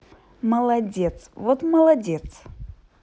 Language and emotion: Russian, positive